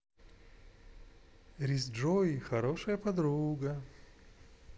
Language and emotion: Russian, positive